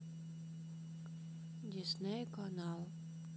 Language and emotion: Russian, neutral